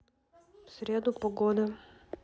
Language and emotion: Russian, neutral